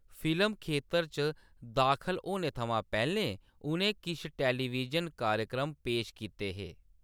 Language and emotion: Dogri, neutral